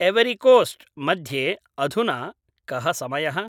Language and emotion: Sanskrit, neutral